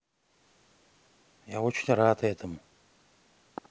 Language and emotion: Russian, neutral